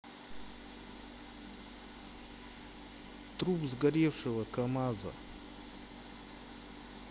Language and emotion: Russian, neutral